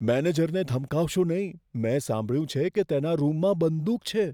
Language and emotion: Gujarati, fearful